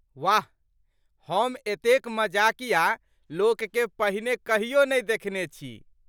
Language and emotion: Maithili, surprised